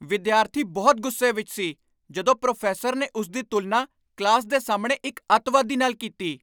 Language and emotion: Punjabi, angry